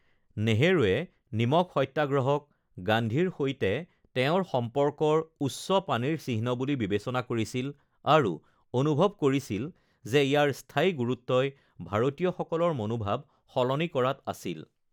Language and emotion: Assamese, neutral